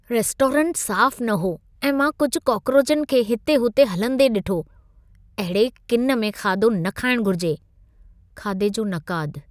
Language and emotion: Sindhi, disgusted